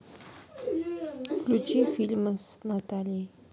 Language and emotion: Russian, neutral